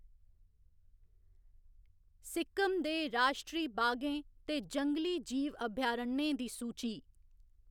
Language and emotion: Dogri, neutral